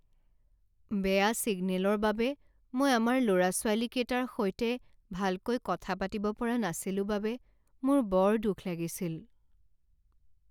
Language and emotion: Assamese, sad